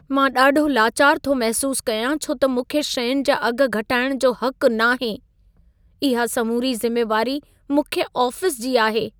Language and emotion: Sindhi, sad